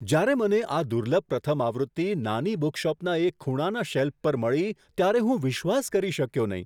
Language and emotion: Gujarati, surprised